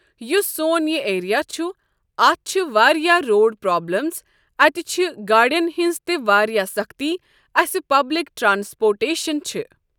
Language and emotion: Kashmiri, neutral